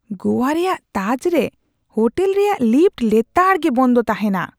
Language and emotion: Santali, disgusted